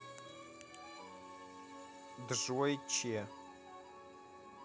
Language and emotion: Russian, neutral